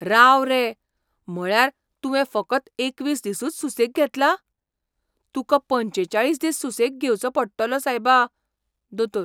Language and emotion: Goan Konkani, surprised